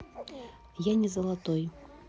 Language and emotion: Russian, neutral